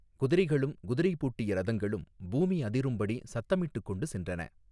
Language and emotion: Tamil, neutral